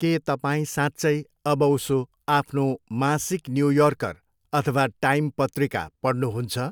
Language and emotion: Nepali, neutral